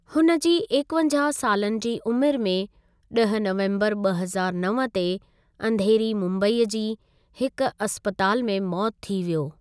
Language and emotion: Sindhi, neutral